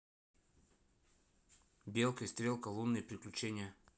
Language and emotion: Russian, neutral